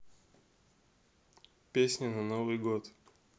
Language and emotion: Russian, neutral